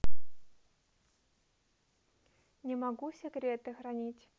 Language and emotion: Russian, neutral